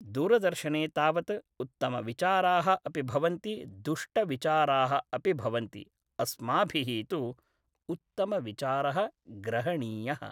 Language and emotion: Sanskrit, neutral